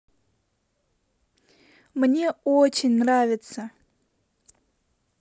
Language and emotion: Russian, positive